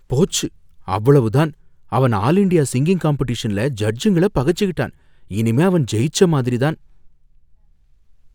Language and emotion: Tamil, fearful